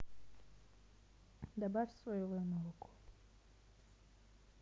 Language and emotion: Russian, neutral